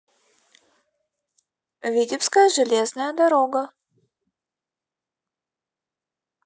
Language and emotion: Russian, neutral